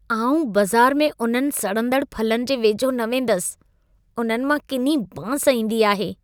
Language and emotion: Sindhi, disgusted